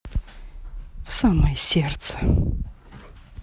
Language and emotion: Russian, sad